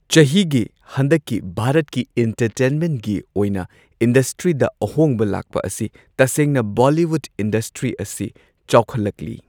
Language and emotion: Manipuri, neutral